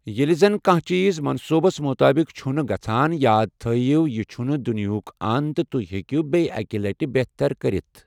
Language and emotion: Kashmiri, neutral